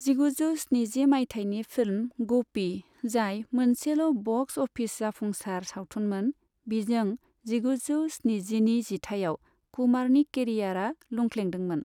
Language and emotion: Bodo, neutral